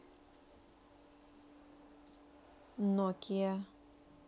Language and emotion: Russian, neutral